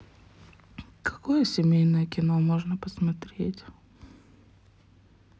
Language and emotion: Russian, sad